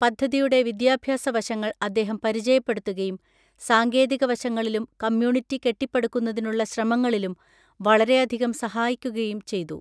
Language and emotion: Malayalam, neutral